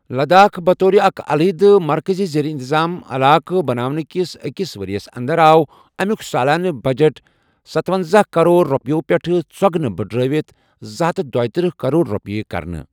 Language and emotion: Kashmiri, neutral